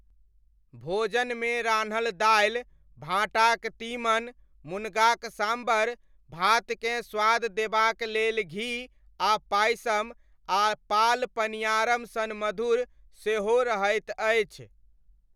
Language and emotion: Maithili, neutral